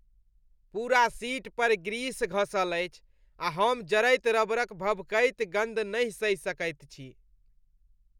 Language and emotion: Maithili, disgusted